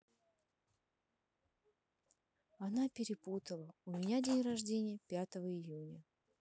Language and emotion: Russian, sad